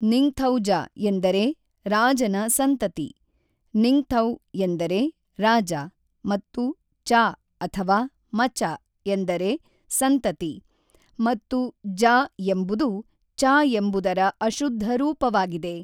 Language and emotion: Kannada, neutral